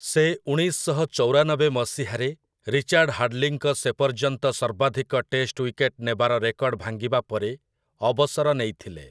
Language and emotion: Odia, neutral